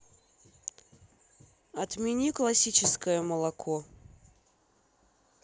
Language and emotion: Russian, neutral